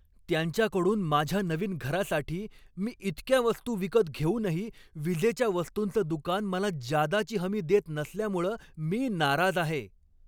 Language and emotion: Marathi, angry